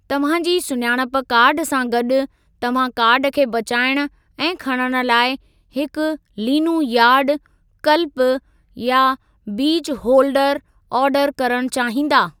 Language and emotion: Sindhi, neutral